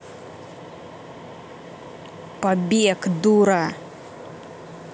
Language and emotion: Russian, angry